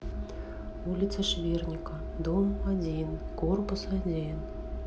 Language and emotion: Russian, neutral